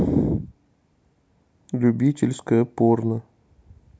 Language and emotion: Russian, neutral